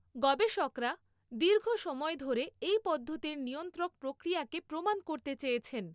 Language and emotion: Bengali, neutral